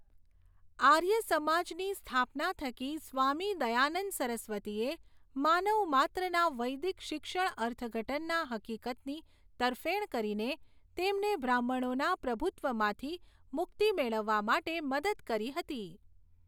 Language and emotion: Gujarati, neutral